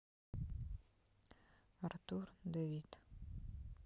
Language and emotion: Russian, neutral